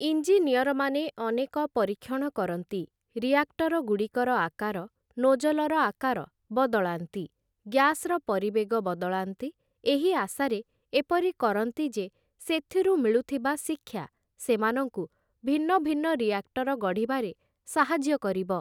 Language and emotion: Odia, neutral